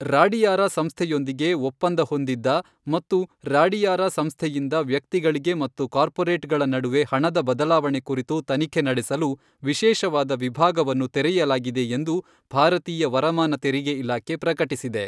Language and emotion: Kannada, neutral